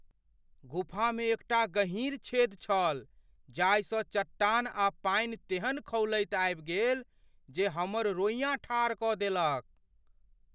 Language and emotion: Maithili, fearful